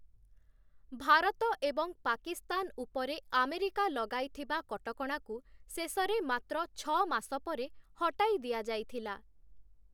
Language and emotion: Odia, neutral